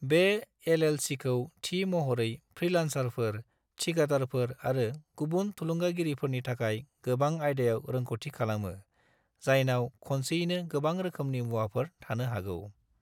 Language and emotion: Bodo, neutral